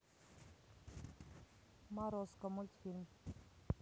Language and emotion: Russian, neutral